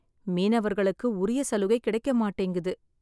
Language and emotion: Tamil, sad